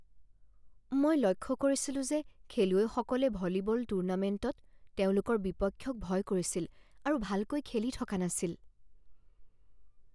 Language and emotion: Assamese, fearful